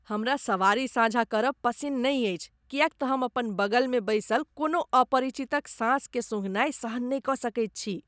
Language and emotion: Maithili, disgusted